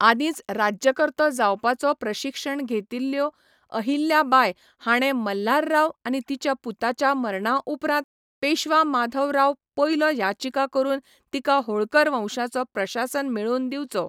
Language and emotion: Goan Konkani, neutral